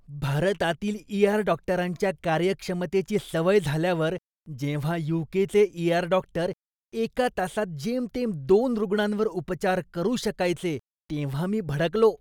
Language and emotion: Marathi, disgusted